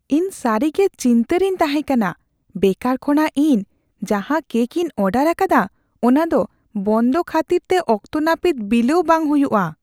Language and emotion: Santali, fearful